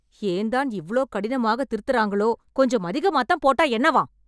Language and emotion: Tamil, angry